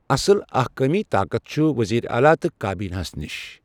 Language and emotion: Kashmiri, neutral